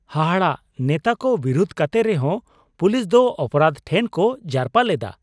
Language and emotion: Santali, surprised